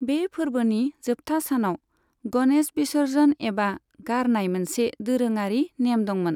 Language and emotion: Bodo, neutral